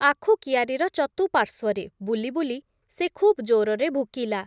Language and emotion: Odia, neutral